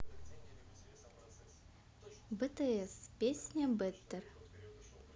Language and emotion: Russian, positive